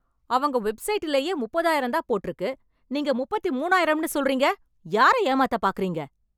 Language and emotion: Tamil, angry